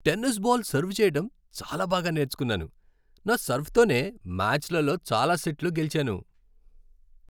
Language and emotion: Telugu, happy